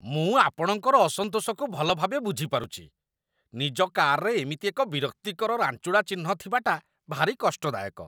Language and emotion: Odia, disgusted